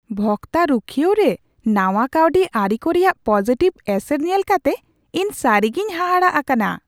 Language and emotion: Santali, surprised